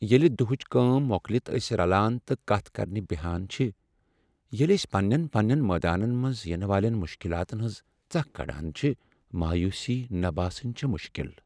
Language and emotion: Kashmiri, sad